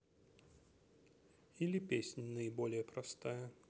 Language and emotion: Russian, neutral